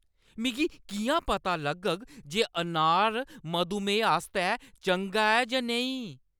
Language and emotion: Dogri, angry